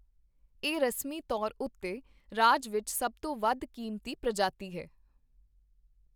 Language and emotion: Punjabi, neutral